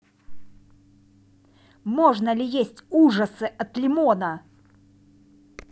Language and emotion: Russian, neutral